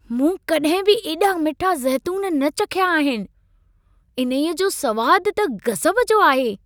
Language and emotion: Sindhi, surprised